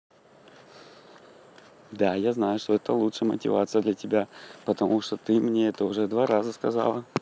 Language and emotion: Russian, positive